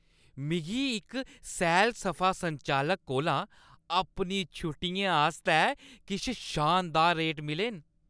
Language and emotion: Dogri, happy